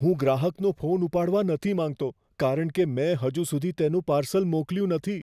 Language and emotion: Gujarati, fearful